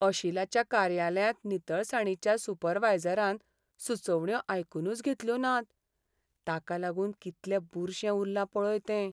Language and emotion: Goan Konkani, sad